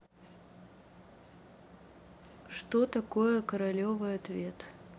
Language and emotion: Russian, neutral